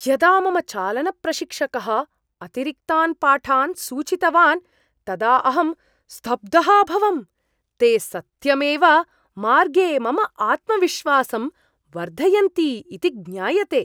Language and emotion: Sanskrit, surprised